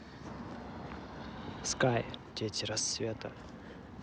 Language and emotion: Russian, neutral